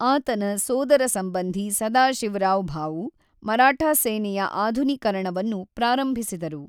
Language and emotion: Kannada, neutral